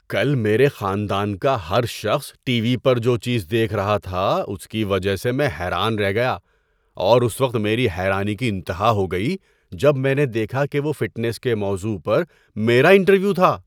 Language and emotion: Urdu, surprised